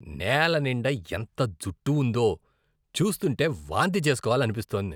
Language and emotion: Telugu, disgusted